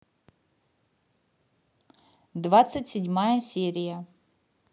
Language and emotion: Russian, neutral